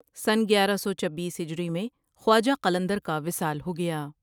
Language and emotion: Urdu, neutral